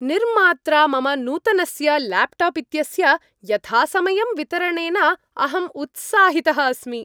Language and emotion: Sanskrit, happy